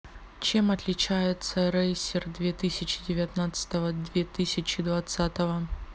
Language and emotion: Russian, neutral